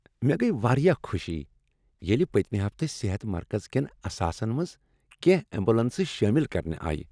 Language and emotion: Kashmiri, happy